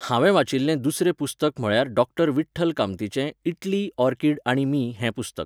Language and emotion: Goan Konkani, neutral